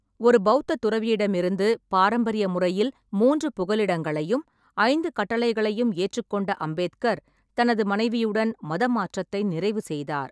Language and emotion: Tamil, neutral